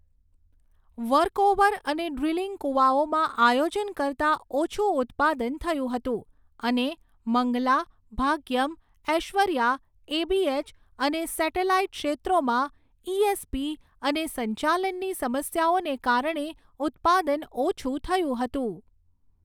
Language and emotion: Gujarati, neutral